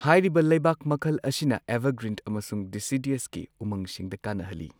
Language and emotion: Manipuri, neutral